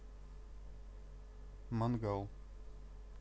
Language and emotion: Russian, neutral